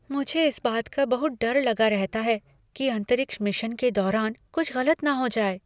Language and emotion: Hindi, fearful